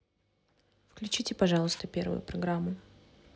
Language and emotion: Russian, neutral